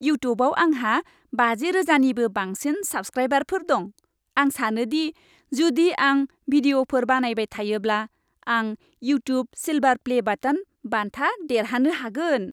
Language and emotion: Bodo, happy